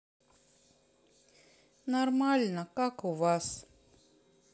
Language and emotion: Russian, sad